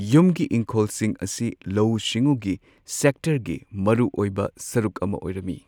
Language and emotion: Manipuri, neutral